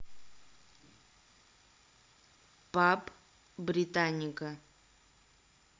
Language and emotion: Russian, neutral